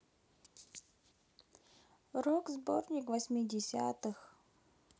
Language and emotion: Russian, neutral